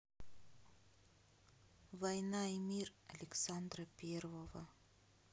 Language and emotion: Russian, sad